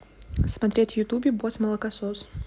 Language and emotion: Russian, neutral